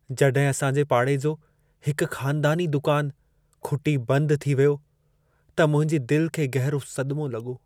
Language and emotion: Sindhi, sad